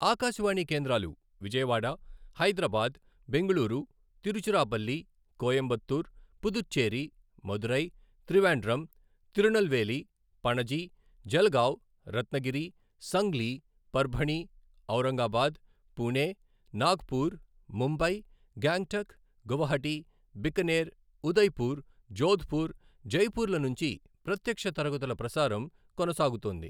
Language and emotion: Telugu, neutral